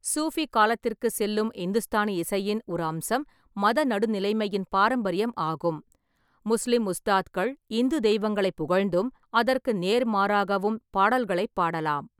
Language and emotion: Tamil, neutral